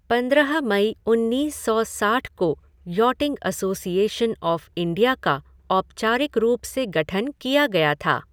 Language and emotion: Hindi, neutral